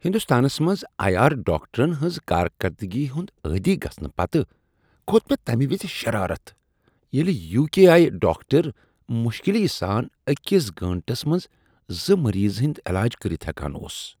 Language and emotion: Kashmiri, disgusted